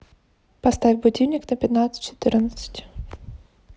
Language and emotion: Russian, neutral